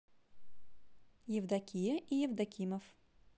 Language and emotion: Russian, neutral